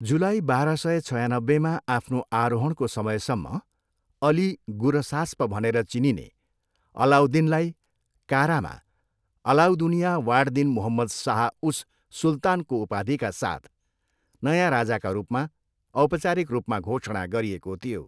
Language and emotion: Nepali, neutral